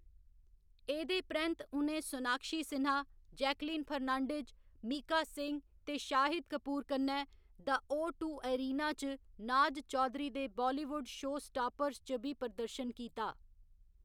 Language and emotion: Dogri, neutral